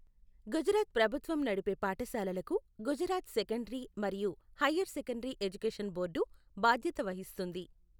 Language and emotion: Telugu, neutral